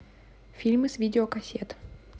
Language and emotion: Russian, neutral